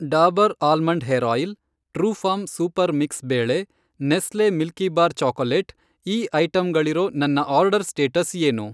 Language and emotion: Kannada, neutral